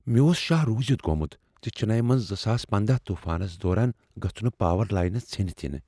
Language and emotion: Kashmiri, fearful